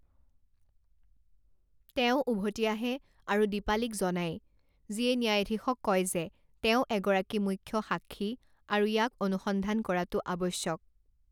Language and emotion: Assamese, neutral